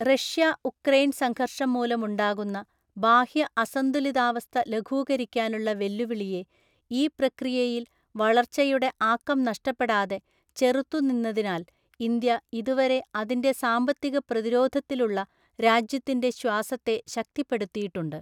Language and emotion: Malayalam, neutral